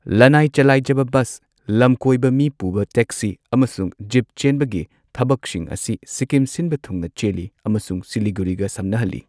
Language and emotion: Manipuri, neutral